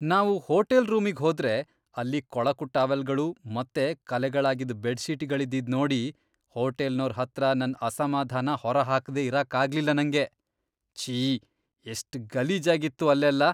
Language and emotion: Kannada, disgusted